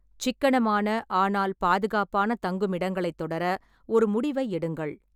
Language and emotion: Tamil, neutral